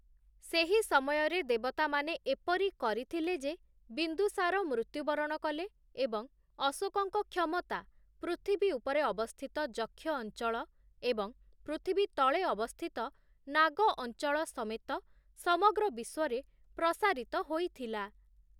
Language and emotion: Odia, neutral